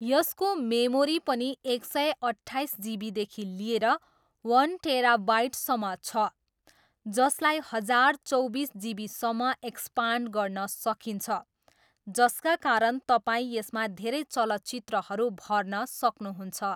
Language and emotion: Nepali, neutral